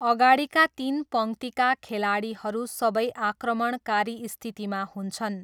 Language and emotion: Nepali, neutral